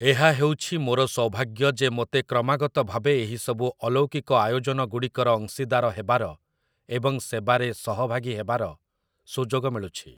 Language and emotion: Odia, neutral